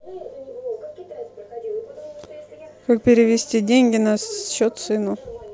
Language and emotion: Russian, neutral